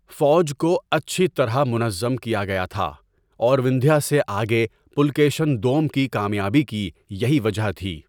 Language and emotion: Urdu, neutral